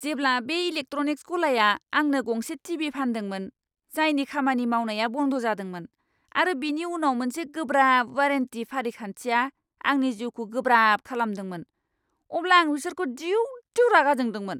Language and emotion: Bodo, angry